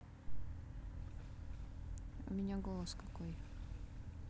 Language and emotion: Russian, neutral